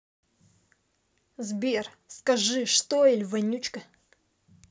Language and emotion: Russian, angry